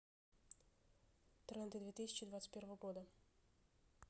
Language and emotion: Russian, neutral